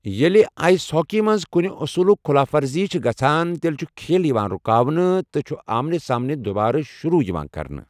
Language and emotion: Kashmiri, neutral